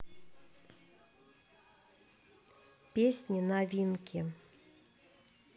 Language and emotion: Russian, neutral